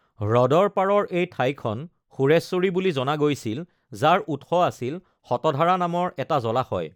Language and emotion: Assamese, neutral